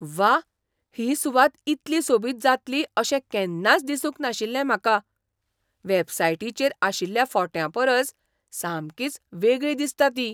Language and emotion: Goan Konkani, surprised